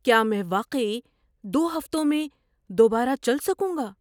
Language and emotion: Urdu, surprised